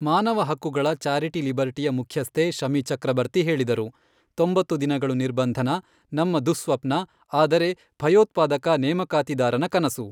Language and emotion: Kannada, neutral